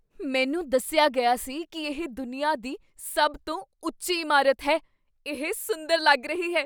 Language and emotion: Punjabi, surprised